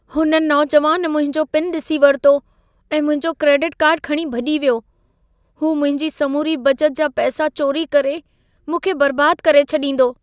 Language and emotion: Sindhi, fearful